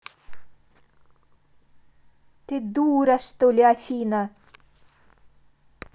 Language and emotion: Russian, angry